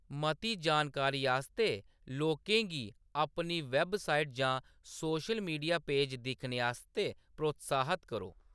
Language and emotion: Dogri, neutral